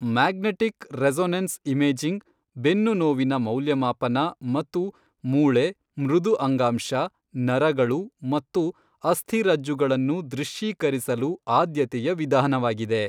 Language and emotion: Kannada, neutral